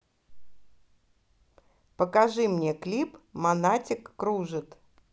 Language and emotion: Russian, neutral